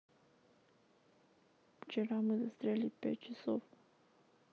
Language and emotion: Russian, sad